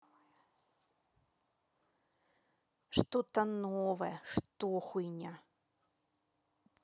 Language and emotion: Russian, neutral